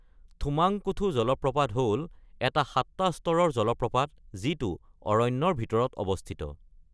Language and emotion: Assamese, neutral